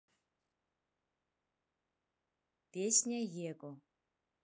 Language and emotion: Russian, neutral